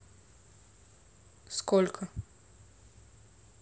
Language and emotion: Russian, neutral